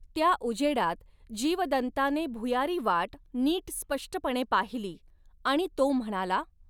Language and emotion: Marathi, neutral